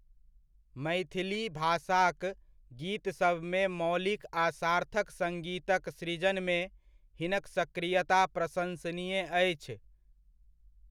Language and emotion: Maithili, neutral